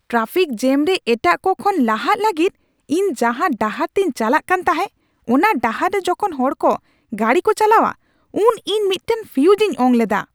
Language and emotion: Santali, angry